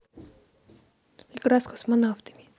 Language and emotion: Russian, neutral